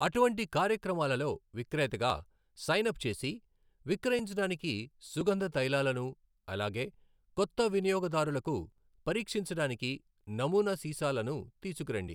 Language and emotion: Telugu, neutral